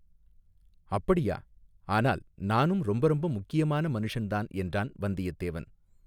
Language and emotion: Tamil, neutral